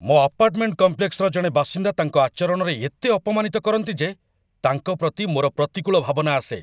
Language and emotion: Odia, angry